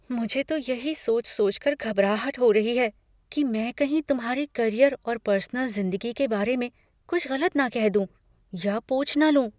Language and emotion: Hindi, fearful